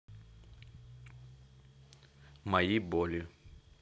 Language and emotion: Russian, neutral